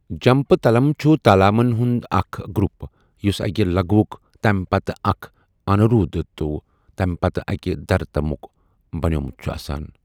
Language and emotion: Kashmiri, neutral